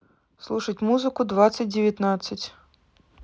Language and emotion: Russian, neutral